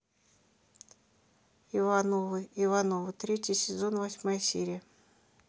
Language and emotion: Russian, neutral